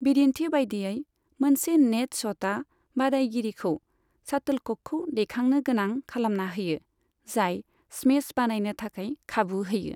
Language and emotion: Bodo, neutral